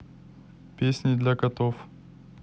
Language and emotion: Russian, neutral